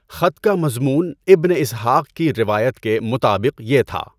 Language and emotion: Urdu, neutral